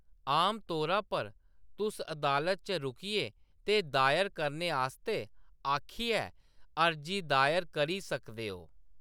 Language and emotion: Dogri, neutral